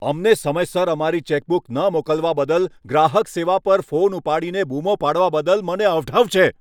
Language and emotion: Gujarati, angry